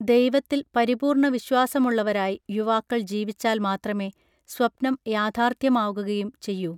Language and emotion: Malayalam, neutral